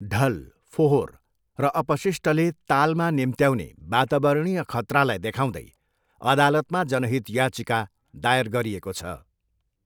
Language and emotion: Nepali, neutral